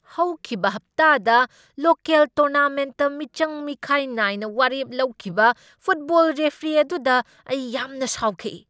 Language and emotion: Manipuri, angry